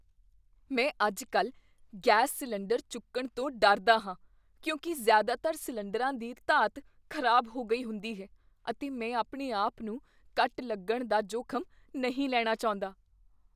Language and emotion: Punjabi, fearful